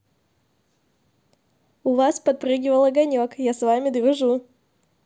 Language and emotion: Russian, positive